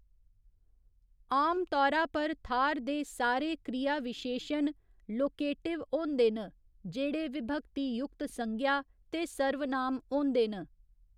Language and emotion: Dogri, neutral